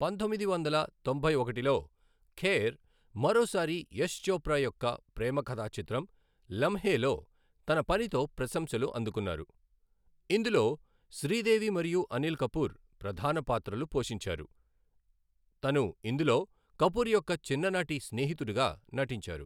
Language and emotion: Telugu, neutral